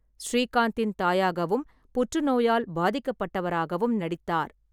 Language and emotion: Tamil, neutral